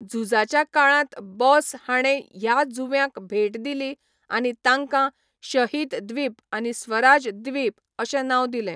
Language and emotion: Goan Konkani, neutral